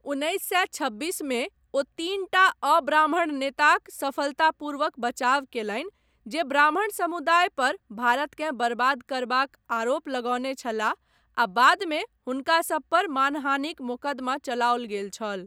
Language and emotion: Maithili, neutral